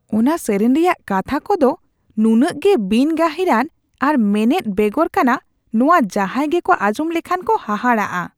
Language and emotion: Santali, disgusted